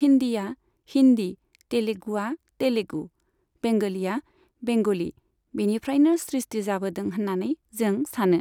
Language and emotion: Bodo, neutral